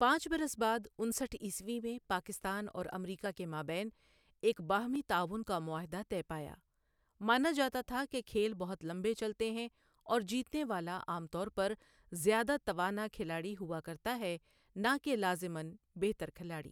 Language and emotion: Urdu, neutral